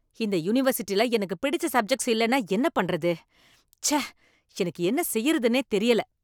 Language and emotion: Tamil, angry